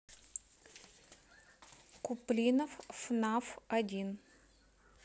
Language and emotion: Russian, neutral